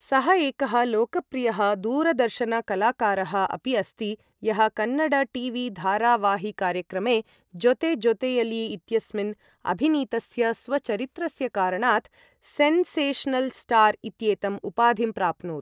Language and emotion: Sanskrit, neutral